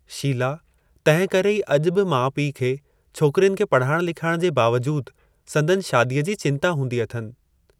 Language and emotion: Sindhi, neutral